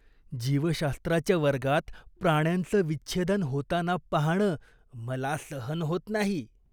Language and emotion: Marathi, disgusted